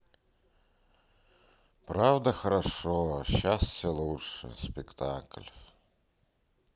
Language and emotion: Russian, sad